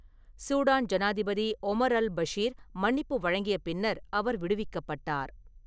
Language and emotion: Tamil, neutral